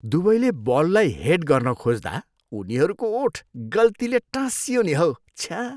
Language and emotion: Nepali, disgusted